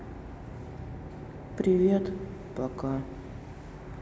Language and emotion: Russian, sad